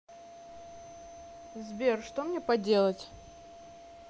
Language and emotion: Russian, neutral